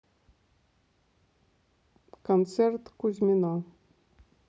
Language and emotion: Russian, neutral